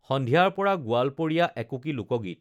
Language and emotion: Assamese, neutral